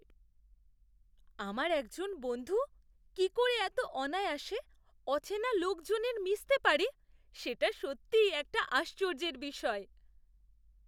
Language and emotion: Bengali, surprised